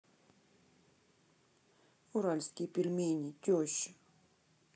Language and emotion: Russian, sad